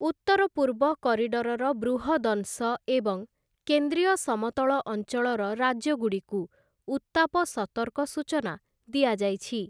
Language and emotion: Odia, neutral